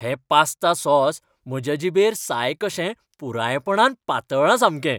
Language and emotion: Goan Konkani, happy